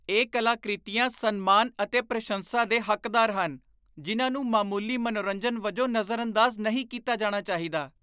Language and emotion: Punjabi, disgusted